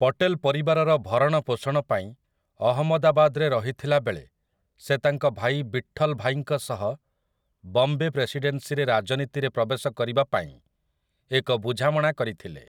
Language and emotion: Odia, neutral